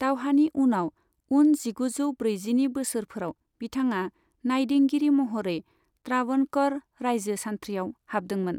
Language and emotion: Bodo, neutral